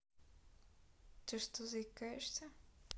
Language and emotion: Russian, neutral